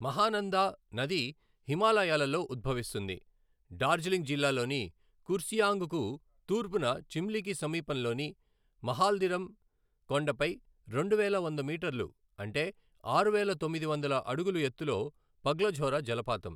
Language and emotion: Telugu, neutral